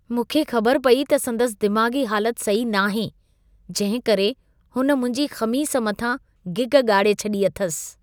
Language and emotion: Sindhi, disgusted